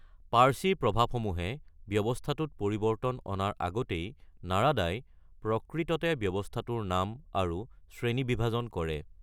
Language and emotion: Assamese, neutral